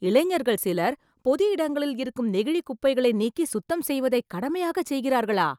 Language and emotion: Tamil, surprised